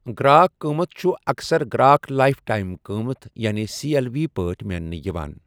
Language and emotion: Kashmiri, neutral